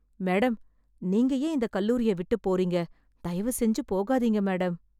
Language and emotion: Tamil, sad